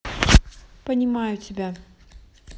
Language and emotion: Russian, neutral